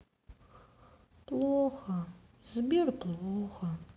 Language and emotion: Russian, sad